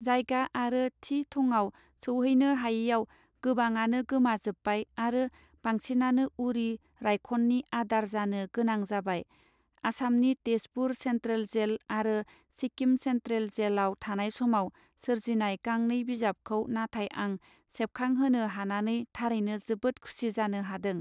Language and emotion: Bodo, neutral